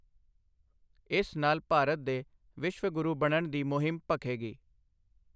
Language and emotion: Punjabi, neutral